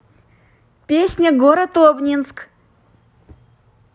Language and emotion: Russian, positive